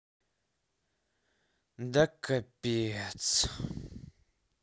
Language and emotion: Russian, sad